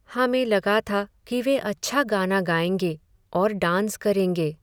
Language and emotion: Hindi, sad